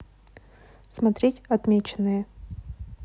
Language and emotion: Russian, neutral